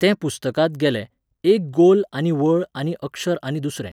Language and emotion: Goan Konkani, neutral